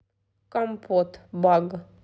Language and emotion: Russian, neutral